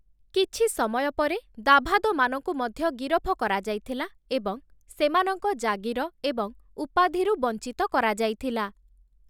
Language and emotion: Odia, neutral